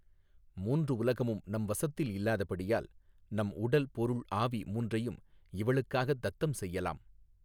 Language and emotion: Tamil, neutral